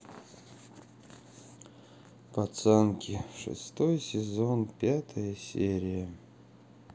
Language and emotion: Russian, sad